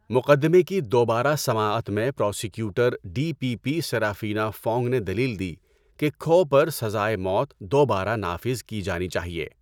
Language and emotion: Urdu, neutral